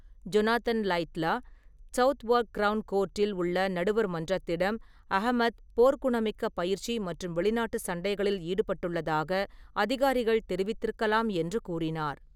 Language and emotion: Tamil, neutral